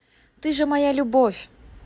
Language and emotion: Russian, positive